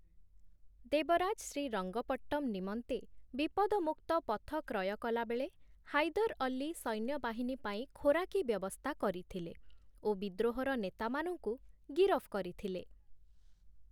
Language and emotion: Odia, neutral